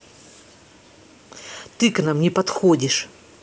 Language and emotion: Russian, angry